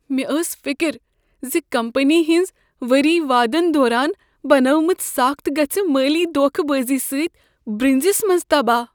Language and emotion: Kashmiri, fearful